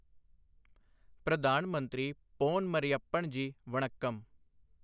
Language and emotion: Punjabi, neutral